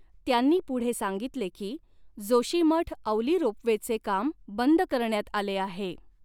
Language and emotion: Marathi, neutral